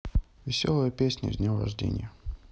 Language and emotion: Russian, neutral